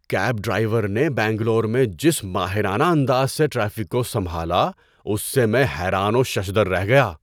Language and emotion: Urdu, surprised